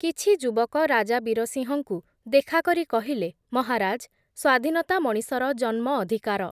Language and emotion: Odia, neutral